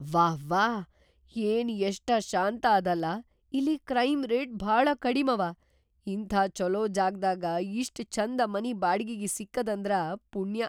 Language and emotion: Kannada, surprised